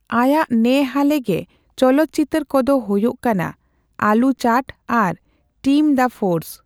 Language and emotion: Santali, neutral